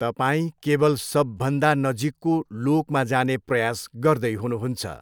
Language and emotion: Nepali, neutral